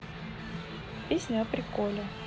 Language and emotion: Russian, neutral